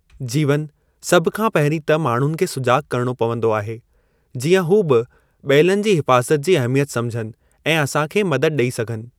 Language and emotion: Sindhi, neutral